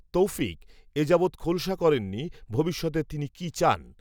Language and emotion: Bengali, neutral